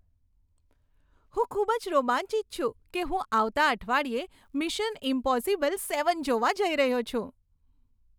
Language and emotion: Gujarati, happy